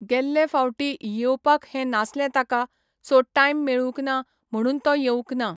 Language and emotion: Goan Konkani, neutral